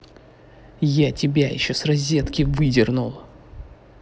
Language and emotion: Russian, angry